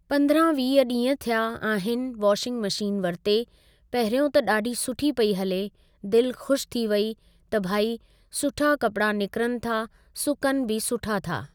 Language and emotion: Sindhi, neutral